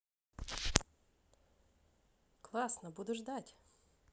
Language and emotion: Russian, positive